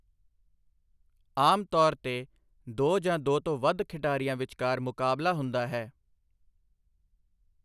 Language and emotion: Punjabi, neutral